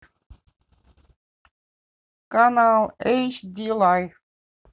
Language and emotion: Russian, neutral